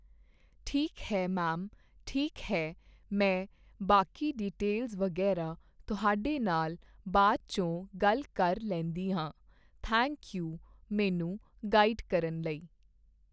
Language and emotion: Punjabi, neutral